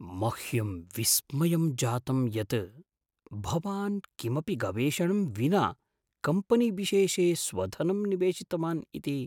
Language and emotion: Sanskrit, surprised